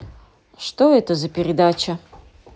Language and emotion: Russian, neutral